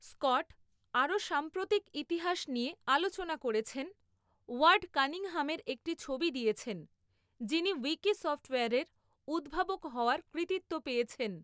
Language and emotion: Bengali, neutral